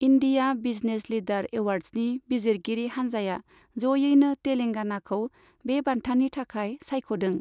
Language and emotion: Bodo, neutral